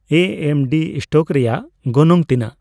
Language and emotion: Santali, neutral